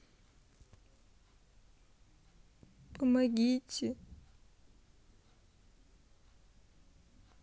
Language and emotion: Russian, sad